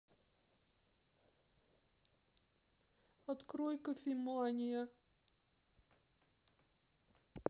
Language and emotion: Russian, sad